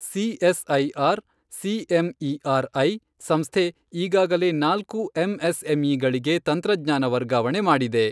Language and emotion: Kannada, neutral